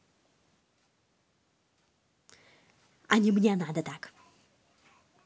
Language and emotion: Russian, angry